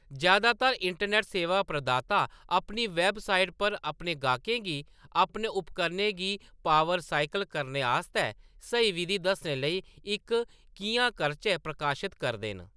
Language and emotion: Dogri, neutral